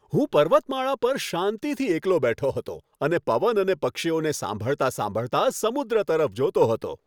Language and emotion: Gujarati, happy